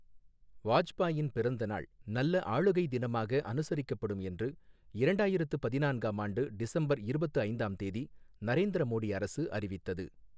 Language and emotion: Tamil, neutral